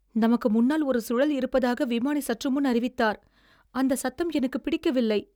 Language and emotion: Tamil, fearful